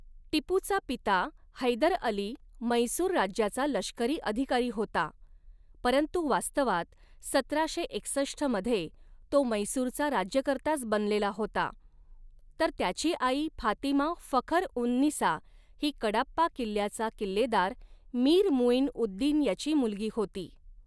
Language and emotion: Marathi, neutral